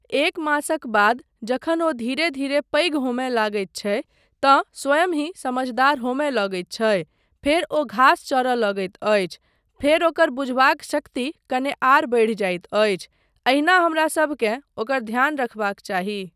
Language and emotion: Maithili, neutral